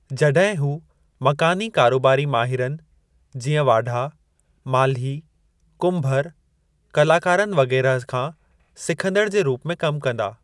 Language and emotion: Sindhi, neutral